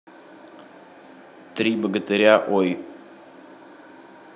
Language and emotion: Russian, neutral